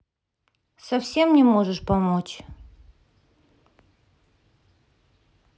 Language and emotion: Russian, sad